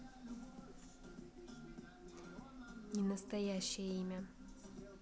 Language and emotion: Russian, neutral